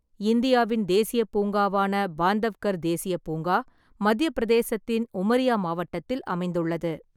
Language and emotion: Tamil, neutral